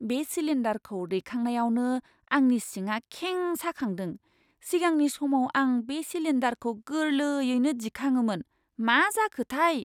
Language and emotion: Bodo, surprised